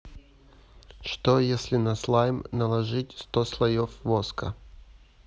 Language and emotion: Russian, neutral